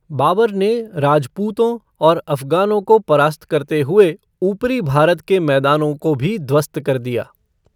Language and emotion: Hindi, neutral